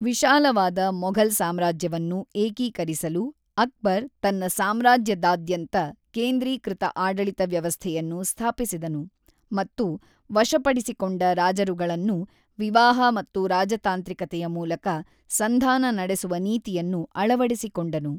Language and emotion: Kannada, neutral